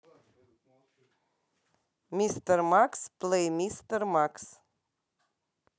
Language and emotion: Russian, neutral